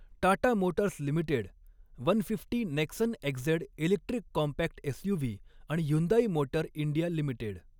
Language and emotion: Marathi, neutral